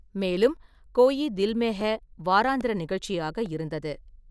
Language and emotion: Tamil, neutral